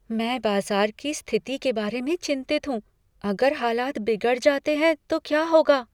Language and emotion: Hindi, fearful